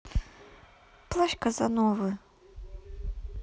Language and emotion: Russian, sad